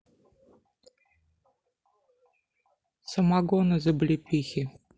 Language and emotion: Russian, neutral